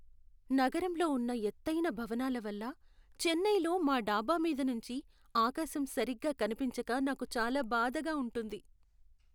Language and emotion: Telugu, sad